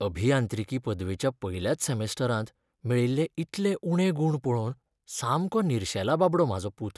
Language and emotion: Goan Konkani, sad